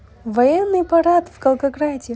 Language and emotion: Russian, positive